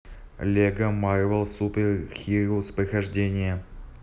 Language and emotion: Russian, neutral